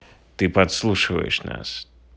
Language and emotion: Russian, neutral